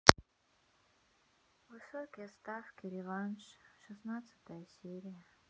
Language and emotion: Russian, sad